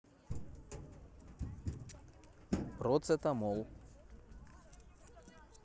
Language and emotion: Russian, neutral